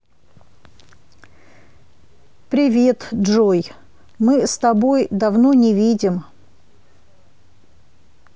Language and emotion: Russian, neutral